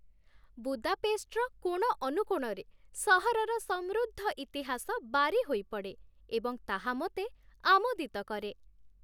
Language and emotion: Odia, happy